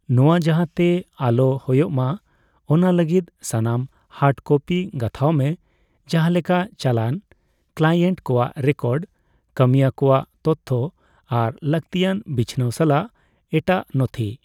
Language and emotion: Santali, neutral